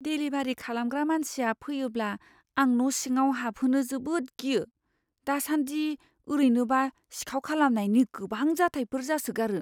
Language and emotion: Bodo, fearful